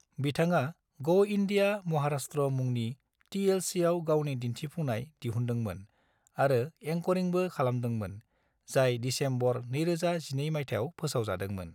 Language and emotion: Bodo, neutral